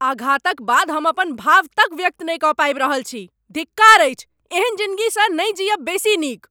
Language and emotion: Maithili, angry